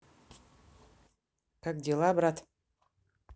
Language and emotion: Russian, neutral